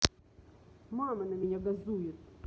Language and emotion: Russian, angry